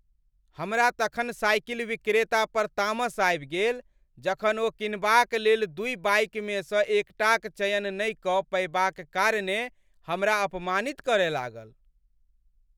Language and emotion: Maithili, angry